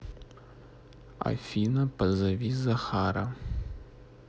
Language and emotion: Russian, neutral